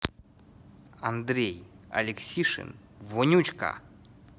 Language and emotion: Russian, neutral